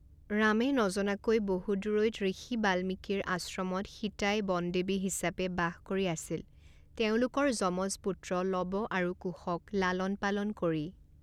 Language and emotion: Assamese, neutral